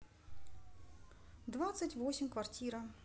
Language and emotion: Russian, neutral